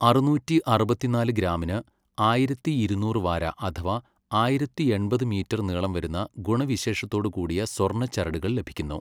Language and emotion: Malayalam, neutral